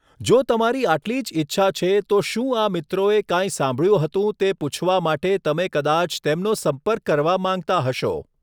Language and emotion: Gujarati, neutral